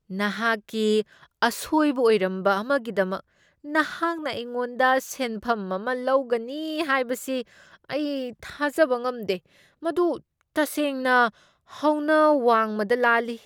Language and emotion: Manipuri, disgusted